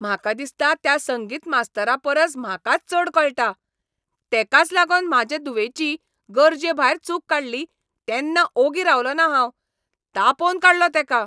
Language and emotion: Goan Konkani, angry